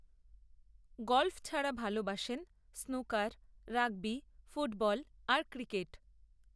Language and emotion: Bengali, neutral